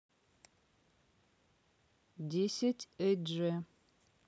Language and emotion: Russian, neutral